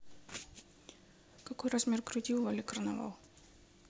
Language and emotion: Russian, neutral